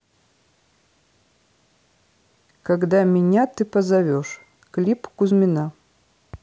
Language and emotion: Russian, neutral